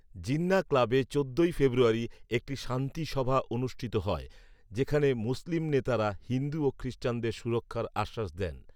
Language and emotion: Bengali, neutral